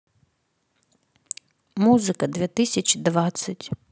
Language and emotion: Russian, neutral